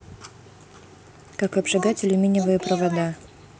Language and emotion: Russian, neutral